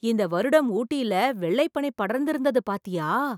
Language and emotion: Tamil, surprised